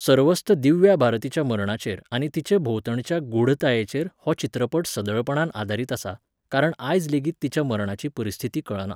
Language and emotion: Goan Konkani, neutral